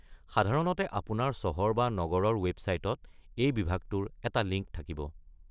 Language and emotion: Assamese, neutral